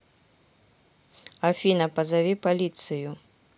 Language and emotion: Russian, neutral